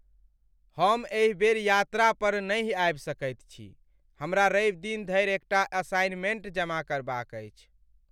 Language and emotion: Maithili, sad